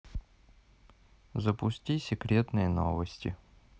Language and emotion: Russian, neutral